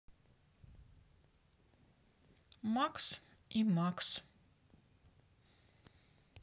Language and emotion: Russian, neutral